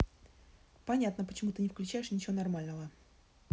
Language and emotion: Russian, neutral